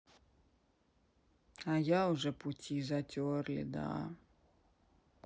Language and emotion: Russian, sad